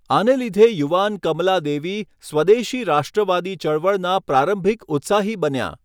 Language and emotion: Gujarati, neutral